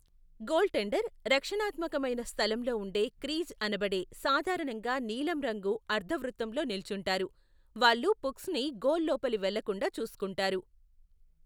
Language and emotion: Telugu, neutral